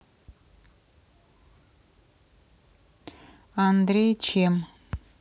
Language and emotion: Russian, neutral